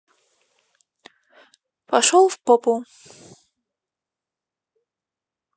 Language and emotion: Russian, neutral